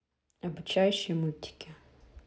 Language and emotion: Russian, neutral